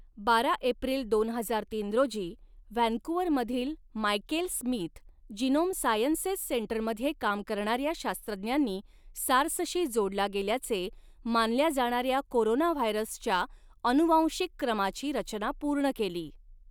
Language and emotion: Marathi, neutral